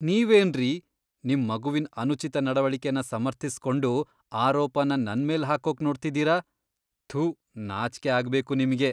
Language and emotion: Kannada, disgusted